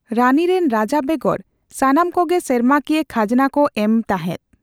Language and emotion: Santali, neutral